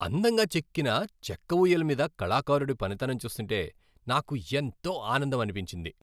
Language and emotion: Telugu, happy